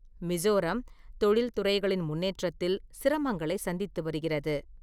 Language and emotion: Tamil, neutral